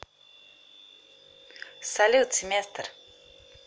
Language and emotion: Russian, neutral